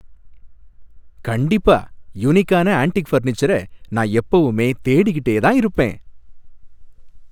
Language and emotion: Tamil, happy